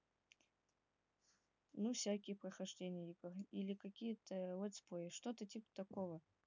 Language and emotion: Russian, neutral